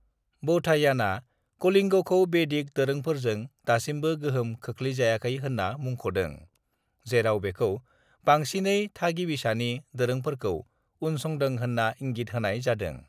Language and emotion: Bodo, neutral